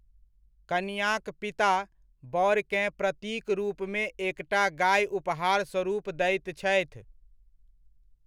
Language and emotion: Maithili, neutral